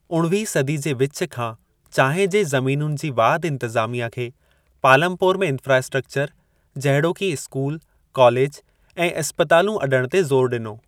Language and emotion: Sindhi, neutral